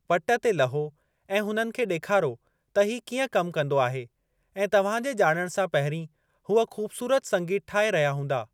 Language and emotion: Sindhi, neutral